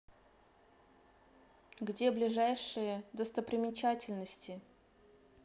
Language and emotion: Russian, neutral